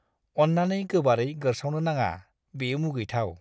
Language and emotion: Bodo, disgusted